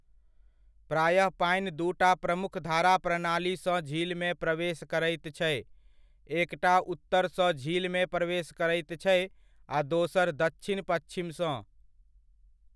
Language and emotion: Maithili, neutral